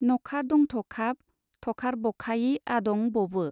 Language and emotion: Bodo, neutral